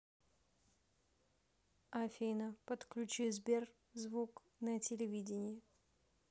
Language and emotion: Russian, neutral